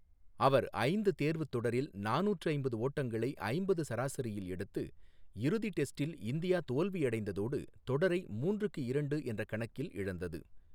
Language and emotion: Tamil, neutral